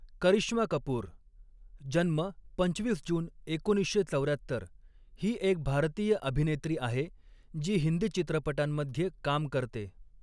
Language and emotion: Marathi, neutral